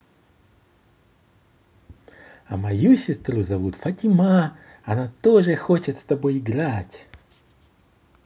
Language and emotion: Russian, positive